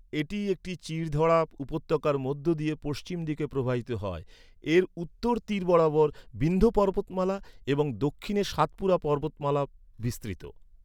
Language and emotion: Bengali, neutral